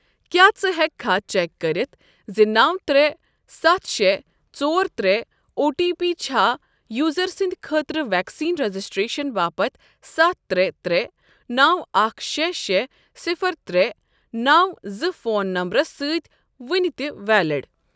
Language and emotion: Kashmiri, neutral